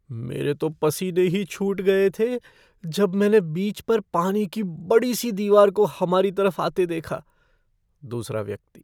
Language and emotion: Hindi, fearful